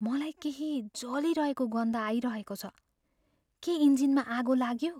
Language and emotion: Nepali, fearful